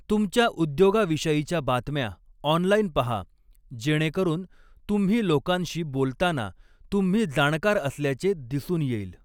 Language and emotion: Marathi, neutral